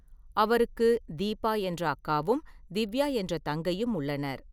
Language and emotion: Tamil, neutral